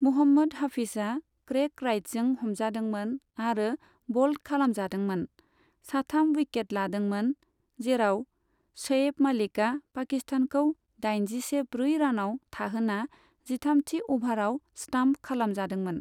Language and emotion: Bodo, neutral